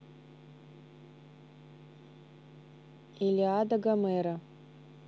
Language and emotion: Russian, neutral